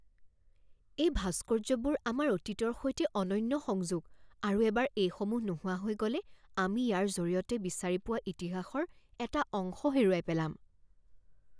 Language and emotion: Assamese, fearful